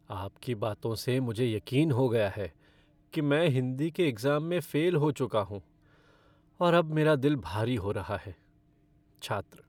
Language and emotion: Hindi, sad